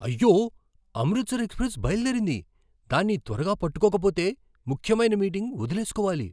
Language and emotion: Telugu, surprised